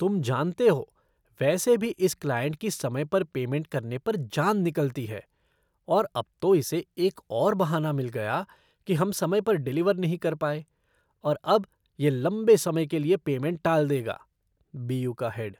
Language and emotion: Hindi, disgusted